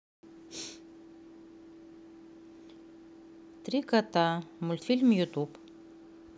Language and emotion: Russian, neutral